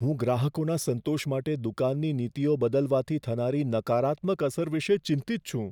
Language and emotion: Gujarati, fearful